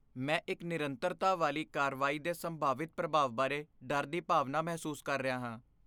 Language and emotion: Punjabi, fearful